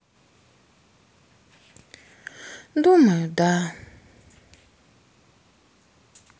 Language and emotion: Russian, sad